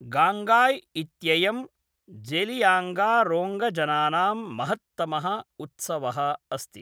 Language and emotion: Sanskrit, neutral